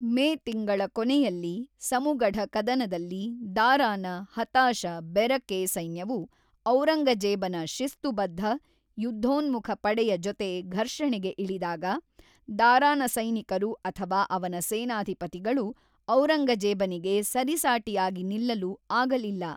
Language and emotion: Kannada, neutral